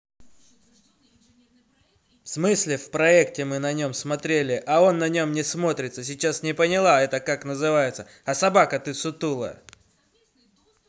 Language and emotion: Russian, angry